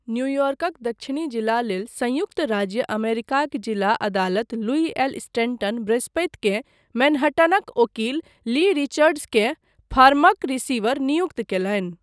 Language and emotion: Maithili, neutral